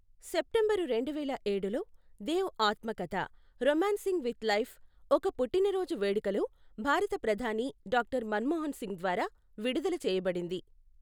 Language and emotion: Telugu, neutral